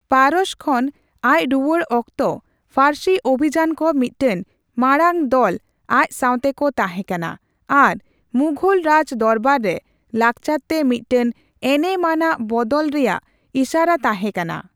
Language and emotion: Santali, neutral